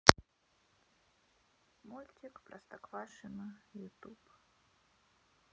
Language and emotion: Russian, neutral